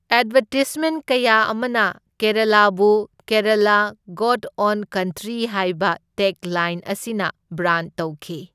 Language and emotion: Manipuri, neutral